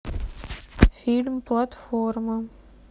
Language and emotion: Russian, neutral